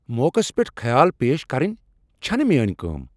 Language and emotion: Kashmiri, angry